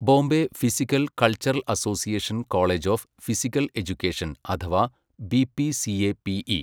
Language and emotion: Malayalam, neutral